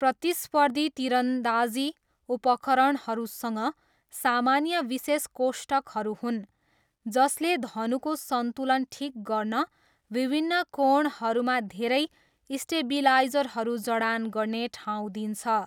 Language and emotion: Nepali, neutral